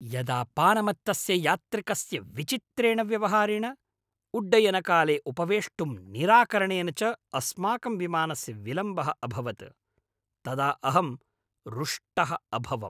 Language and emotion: Sanskrit, angry